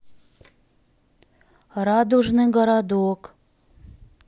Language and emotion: Russian, neutral